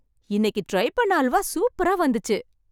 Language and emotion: Tamil, happy